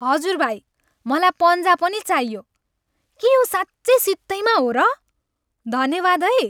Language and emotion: Nepali, happy